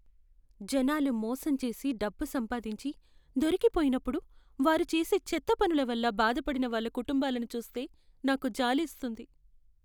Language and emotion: Telugu, sad